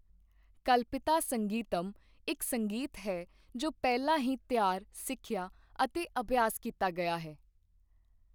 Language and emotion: Punjabi, neutral